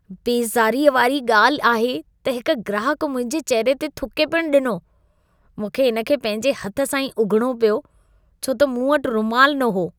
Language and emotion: Sindhi, disgusted